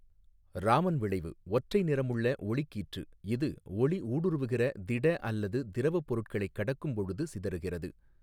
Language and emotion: Tamil, neutral